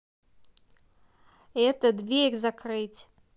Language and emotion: Russian, angry